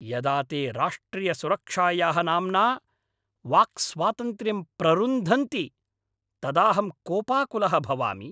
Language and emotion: Sanskrit, angry